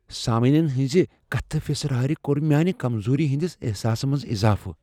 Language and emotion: Kashmiri, fearful